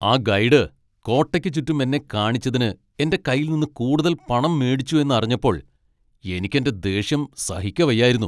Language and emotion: Malayalam, angry